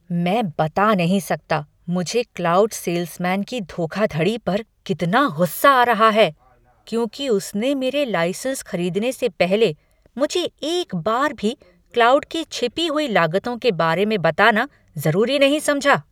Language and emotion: Hindi, angry